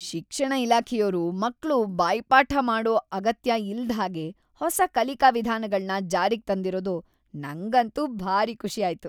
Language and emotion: Kannada, happy